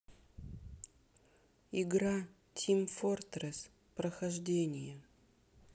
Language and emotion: Russian, sad